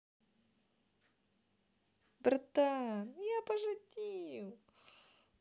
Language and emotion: Russian, positive